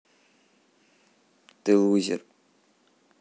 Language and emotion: Russian, neutral